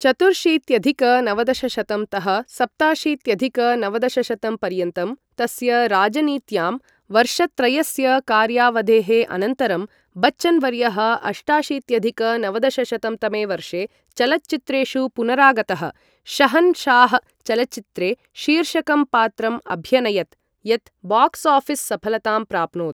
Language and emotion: Sanskrit, neutral